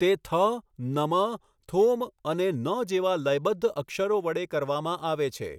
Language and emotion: Gujarati, neutral